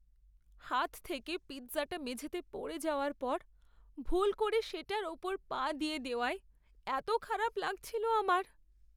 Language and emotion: Bengali, sad